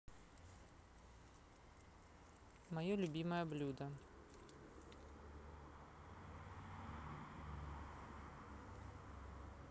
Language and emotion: Russian, neutral